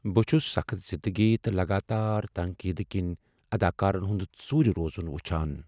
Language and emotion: Kashmiri, sad